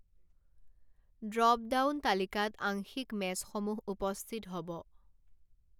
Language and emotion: Assamese, neutral